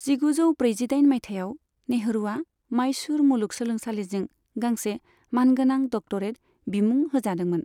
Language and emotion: Bodo, neutral